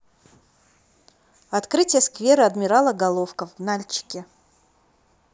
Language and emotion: Russian, neutral